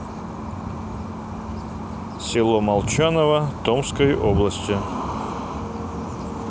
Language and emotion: Russian, neutral